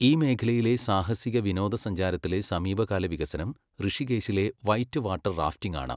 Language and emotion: Malayalam, neutral